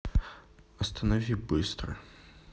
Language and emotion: Russian, sad